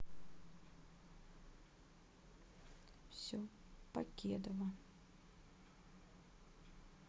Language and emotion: Russian, sad